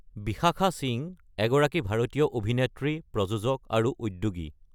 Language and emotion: Assamese, neutral